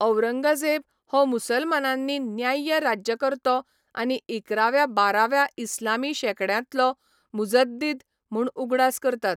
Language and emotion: Goan Konkani, neutral